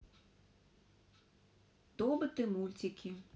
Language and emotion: Russian, neutral